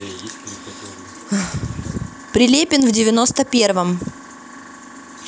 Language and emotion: Russian, neutral